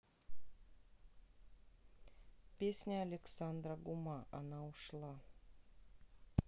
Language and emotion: Russian, neutral